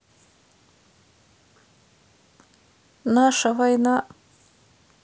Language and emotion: Russian, sad